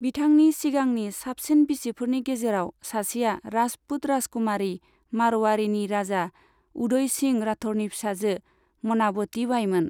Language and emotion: Bodo, neutral